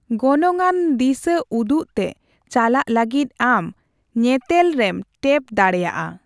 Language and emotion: Santali, neutral